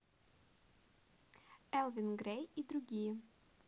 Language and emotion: Russian, positive